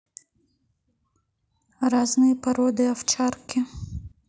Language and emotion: Russian, neutral